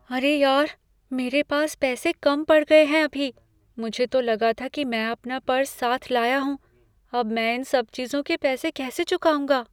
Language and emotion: Hindi, fearful